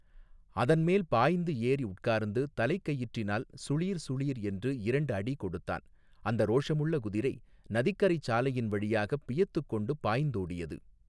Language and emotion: Tamil, neutral